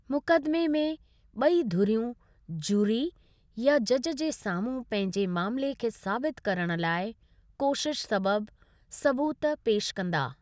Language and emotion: Sindhi, neutral